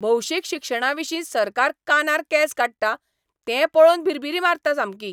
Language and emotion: Goan Konkani, angry